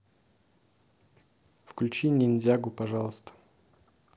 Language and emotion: Russian, neutral